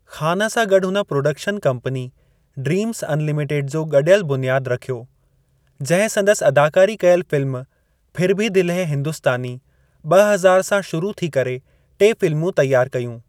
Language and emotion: Sindhi, neutral